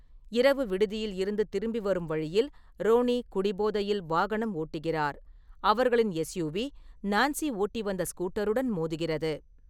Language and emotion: Tamil, neutral